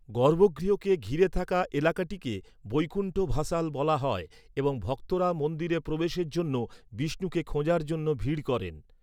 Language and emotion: Bengali, neutral